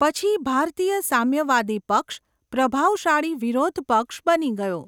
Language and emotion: Gujarati, neutral